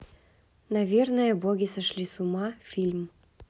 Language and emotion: Russian, neutral